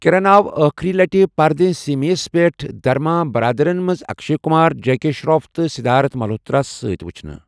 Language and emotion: Kashmiri, neutral